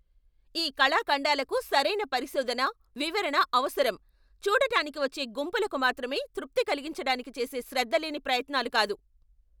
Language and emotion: Telugu, angry